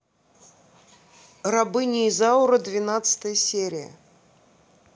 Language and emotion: Russian, neutral